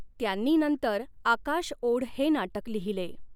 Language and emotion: Marathi, neutral